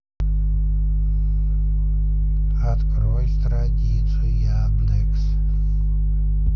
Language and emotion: Russian, neutral